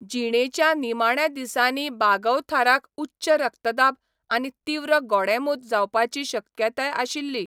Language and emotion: Goan Konkani, neutral